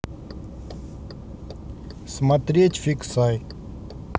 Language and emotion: Russian, neutral